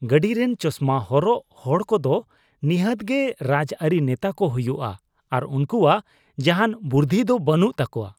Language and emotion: Santali, disgusted